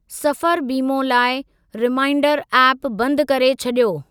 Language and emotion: Sindhi, neutral